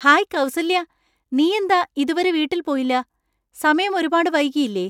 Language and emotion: Malayalam, surprised